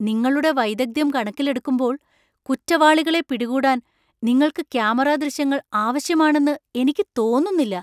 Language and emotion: Malayalam, surprised